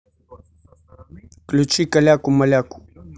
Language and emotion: Russian, neutral